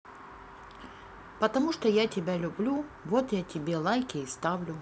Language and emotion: Russian, neutral